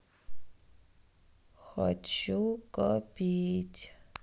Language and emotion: Russian, sad